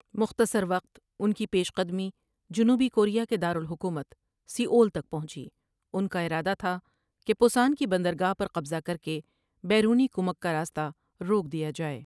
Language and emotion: Urdu, neutral